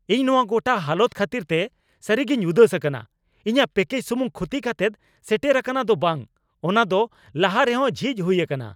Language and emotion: Santali, angry